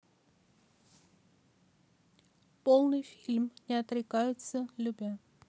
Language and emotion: Russian, neutral